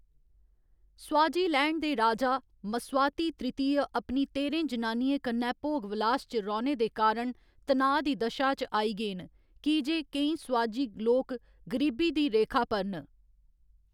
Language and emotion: Dogri, neutral